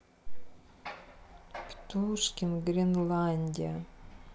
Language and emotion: Russian, sad